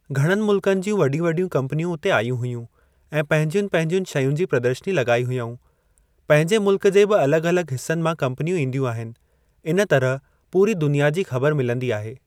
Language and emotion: Sindhi, neutral